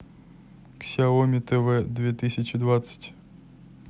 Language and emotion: Russian, neutral